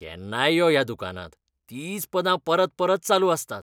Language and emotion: Goan Konkani, disgusted